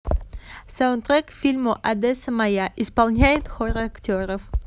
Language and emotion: Russian, positive